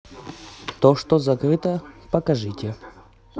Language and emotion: Russian, neutral